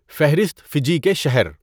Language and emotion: Urdu, neutral